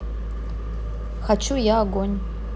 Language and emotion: Russian, neutral